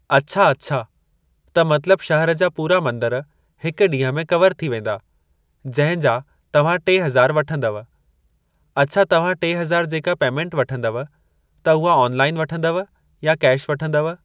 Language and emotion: Sindhi, neutral